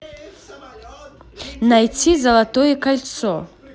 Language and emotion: Russian, neutral